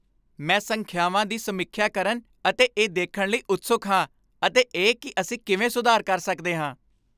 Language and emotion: Punjabi, happy